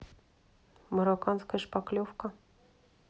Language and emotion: Russian, neutral